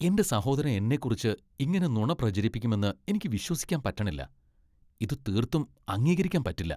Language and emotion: Malayalam, disgusted